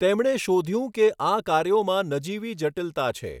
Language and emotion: Gujarati, neutral